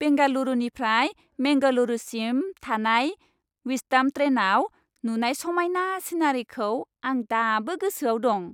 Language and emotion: Bodo, happy